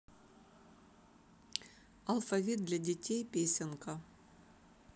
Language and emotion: Russian, neutral